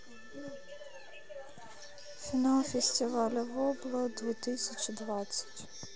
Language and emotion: Russian, sad